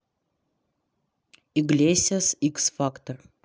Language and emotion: Russian, neutral